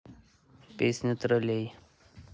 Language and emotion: Russian, neutral